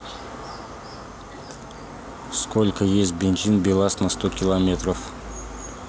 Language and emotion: Russian, neutral